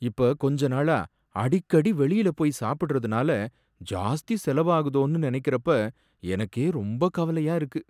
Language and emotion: Tamil, sad